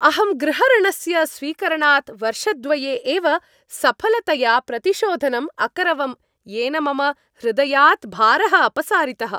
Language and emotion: Sanskrit, happy